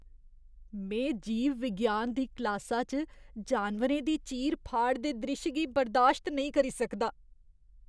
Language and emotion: Dogri, disgusted